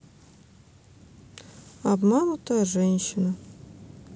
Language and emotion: Russian, sad